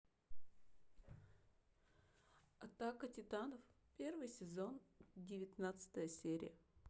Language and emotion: Russian, neutral